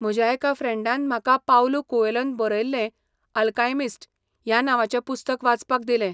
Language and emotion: Goan Konkani, neutral